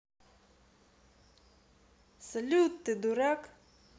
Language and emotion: Russian, neutral